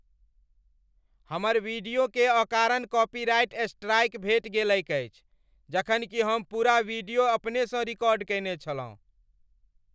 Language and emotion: Maithili, angry